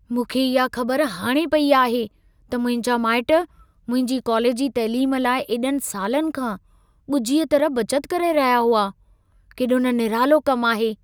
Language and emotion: Sindhi, surprised